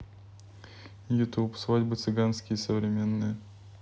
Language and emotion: Russian, neutral